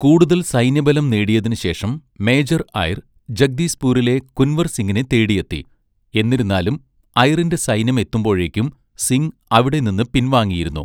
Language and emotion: Malayalam, neutral